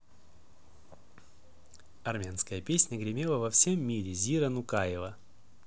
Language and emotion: Russian, positive